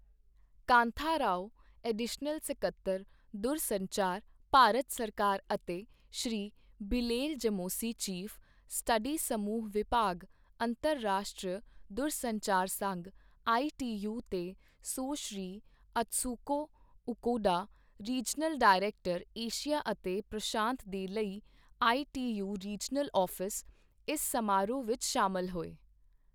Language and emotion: Punjabi, neutral